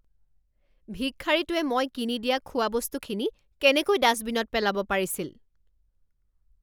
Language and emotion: Assamese, angry